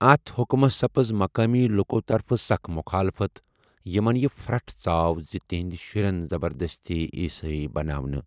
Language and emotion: Kashmiri, neutral